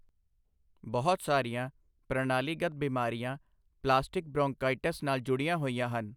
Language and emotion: Punjabi, neutral